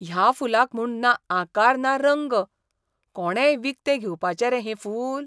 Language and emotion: Goan Konkani, disgusted